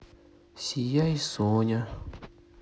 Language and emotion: Russian, sad